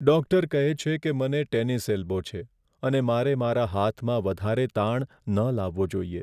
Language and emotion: Gujarati, sad